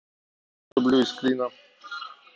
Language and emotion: Russian, neutral